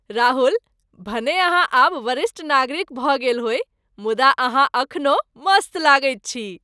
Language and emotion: Maithili, happy